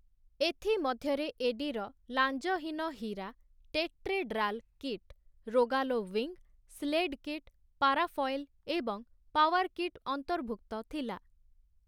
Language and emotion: Odia, neutral